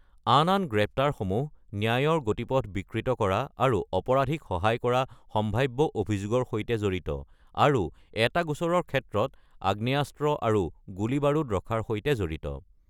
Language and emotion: Assamese, neutral